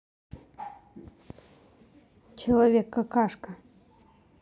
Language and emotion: Russian, neutral